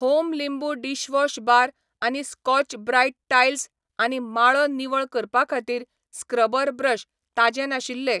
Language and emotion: Goan Konkani, neutral